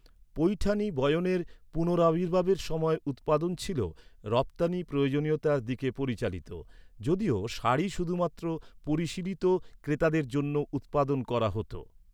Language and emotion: Bengali, neutral